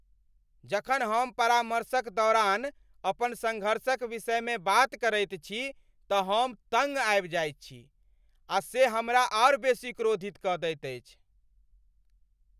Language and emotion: Maithili, angry